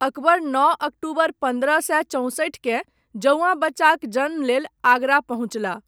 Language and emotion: Maithili, neutral